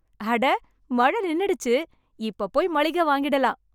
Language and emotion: Tamil, happy